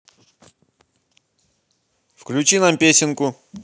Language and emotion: Russian, positive